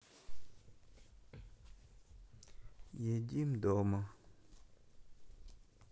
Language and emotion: Russian, neutral